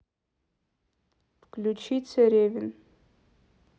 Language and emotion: Russian, neutral